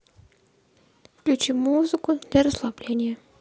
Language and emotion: Russian, neutral